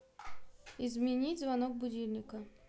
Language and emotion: Russian, neutral